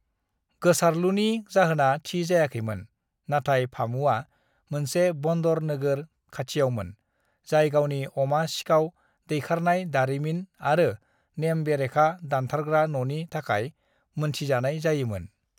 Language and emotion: Bodo, neutral